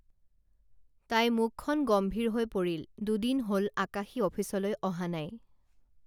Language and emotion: Assamese, neutral